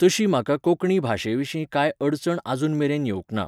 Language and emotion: Goan Konkani, neutral